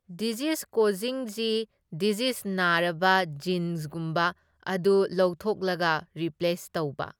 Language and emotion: Manipuri, neutral